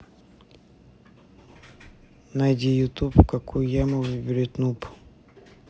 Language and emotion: Russian, neutral